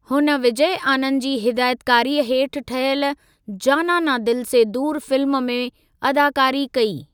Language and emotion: Sindhi, neutral